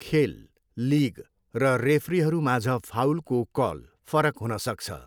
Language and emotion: Nepali, neutral